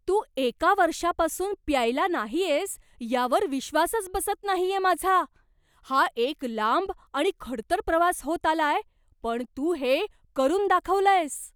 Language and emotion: Marathi, surprised